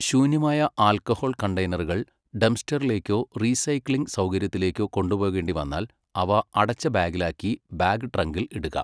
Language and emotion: Malayalam, neutral